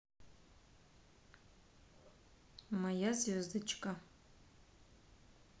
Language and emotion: Russian, neutral